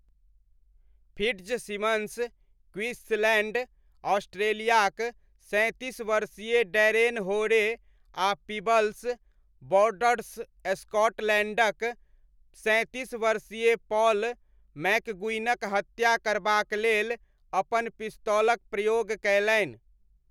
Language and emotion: Maithili, neutral